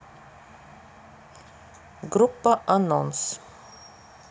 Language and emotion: Russian, neutral